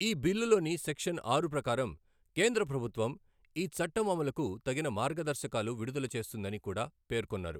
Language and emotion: Telugu, neutral